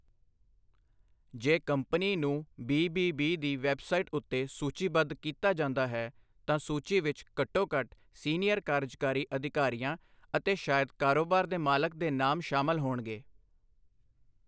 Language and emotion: Punjabi, neutral